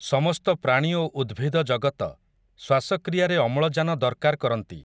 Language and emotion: Odia, neutral